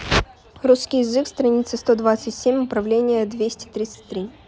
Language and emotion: Russian, neutral